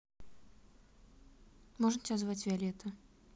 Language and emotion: Russian, neutral